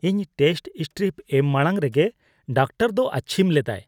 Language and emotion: Santali, disgusted